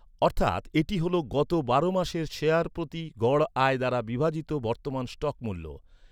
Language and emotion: Bengali, neutral